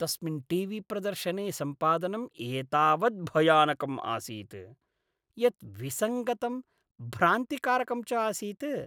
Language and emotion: Sanskrit, disgusted